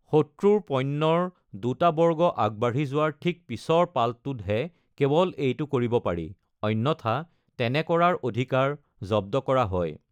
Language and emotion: Assamese, neutral